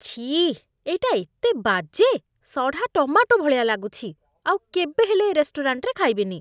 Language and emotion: Odia, disgusted